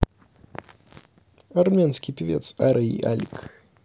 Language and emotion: Russian, neutral